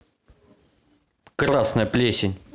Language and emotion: Russian, angry